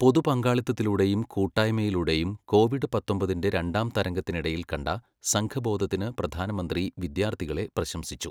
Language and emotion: Malayalam, neutral